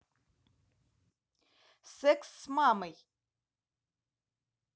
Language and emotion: Russian, neutral